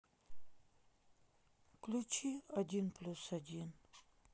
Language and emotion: Russian, sad